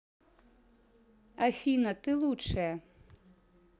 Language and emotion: Russian, positive